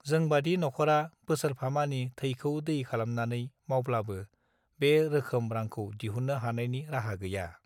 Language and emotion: Bodo, neutral